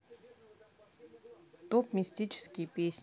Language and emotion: Russian, neutral